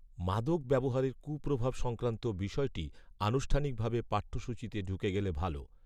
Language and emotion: Bengali, neutral